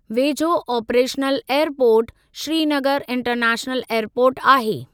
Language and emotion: Sindhi, neutral